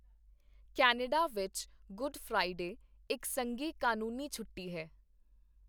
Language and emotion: Punjabi, neutral